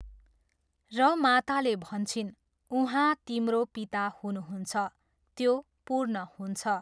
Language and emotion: Nepali, neutral